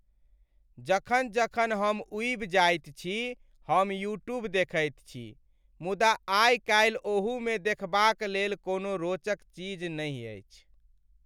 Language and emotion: Maithili, sad